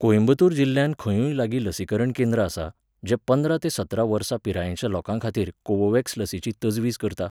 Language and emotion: Goan Konkani, neutral